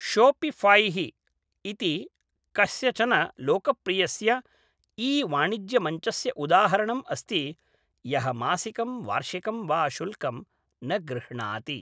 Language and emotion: Sanskrit, neutral